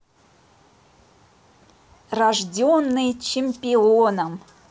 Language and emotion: Russian, positive